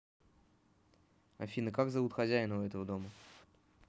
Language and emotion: Russian, neutral